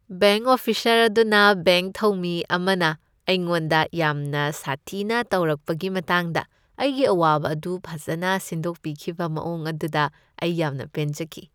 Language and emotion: Manipuri, happy